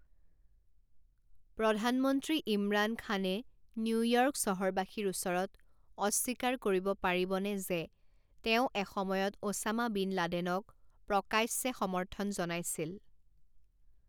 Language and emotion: Assamese, neutral